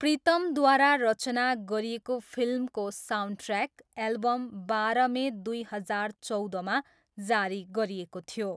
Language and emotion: Nepali, neutral